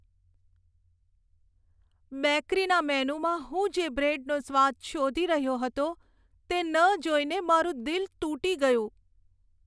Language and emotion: Gujarati, sad